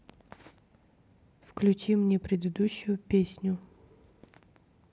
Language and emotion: Russian, neutral